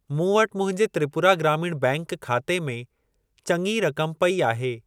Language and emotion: Sindhi, neutral